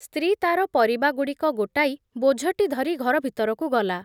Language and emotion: Odia, neutral